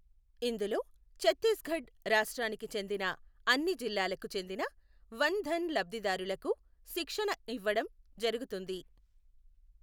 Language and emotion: Telugu, neutral